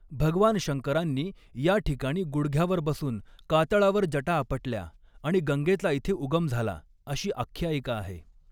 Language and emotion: Marathi, neutral